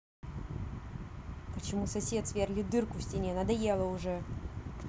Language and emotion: Russian, angry